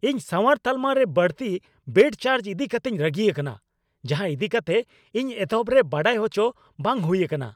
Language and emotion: Santali, angry